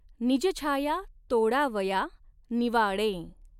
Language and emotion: Marathi, neutral